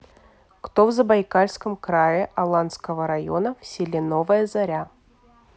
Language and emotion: Russian, neutral